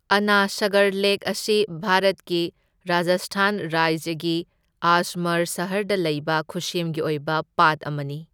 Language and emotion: Manipuri, neutral